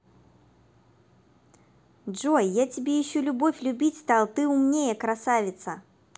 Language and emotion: Russian, positive